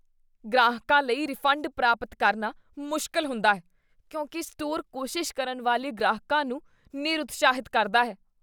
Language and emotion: Punjabi, disgusted